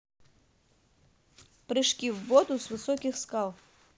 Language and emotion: Russian, neutral